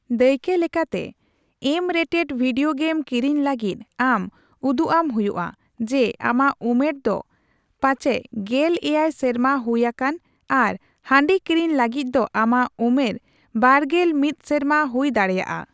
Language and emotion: Santali, neutral